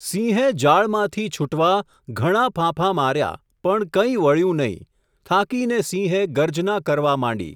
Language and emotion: Gujarati, neutral